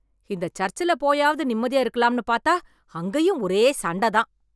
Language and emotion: Tamil, angry